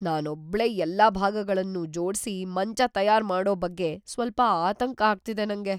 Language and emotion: Kannada, fearful